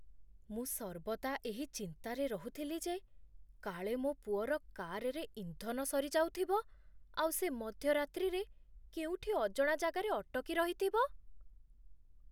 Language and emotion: Odia, fearful